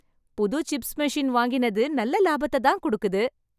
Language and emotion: Tamil, happy